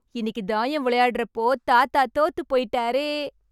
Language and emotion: Tamil, happy